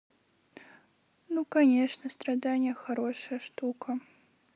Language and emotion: Russian, sad